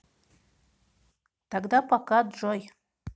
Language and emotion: Russian, neutral